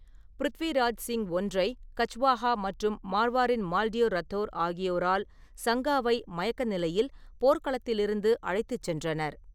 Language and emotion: Tamil, neutral